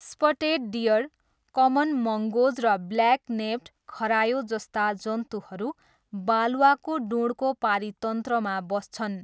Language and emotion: Nepali, neutral